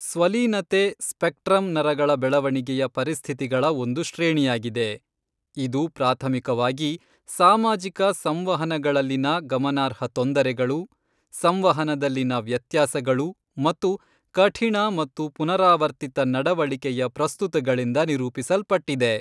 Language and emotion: Kannada, neutral